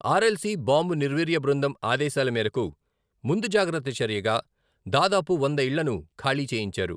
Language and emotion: Telugu, neutral